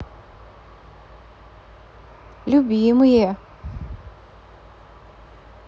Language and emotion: Russian, positive